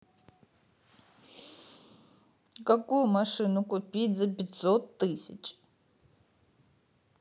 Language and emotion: Russian, sad